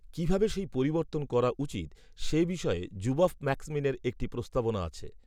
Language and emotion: Bengali, neutral